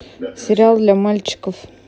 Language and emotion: Russian, neutral